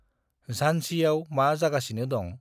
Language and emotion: Bodo, neutral